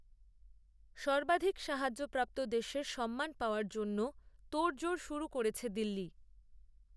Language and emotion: Bengali, neutral